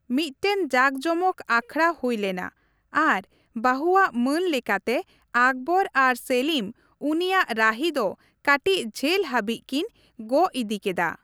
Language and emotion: Santali, neutral